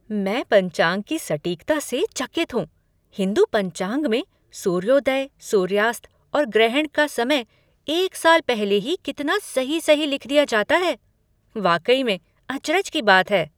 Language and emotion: Hindi, surprised